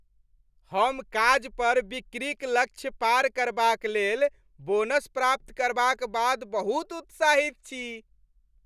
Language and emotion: Maithili, happy